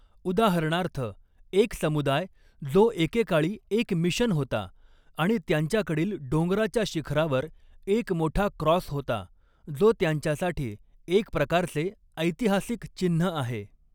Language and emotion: Marathi, neutral